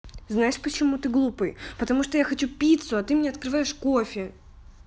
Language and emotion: Russian, angry